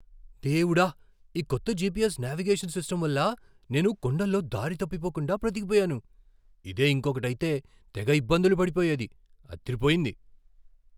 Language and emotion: Telugu, surprised